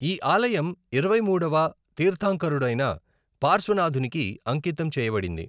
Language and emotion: Telugu, neutral